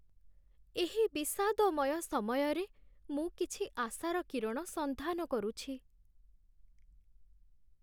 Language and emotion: Odia, sad